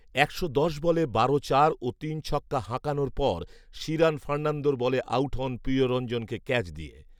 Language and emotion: Bengali, neutral